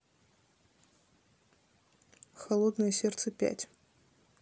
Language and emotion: Russian, neutral